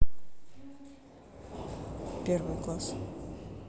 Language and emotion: Russian, neutral